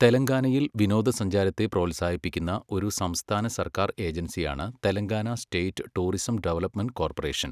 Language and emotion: Malayalam, neutral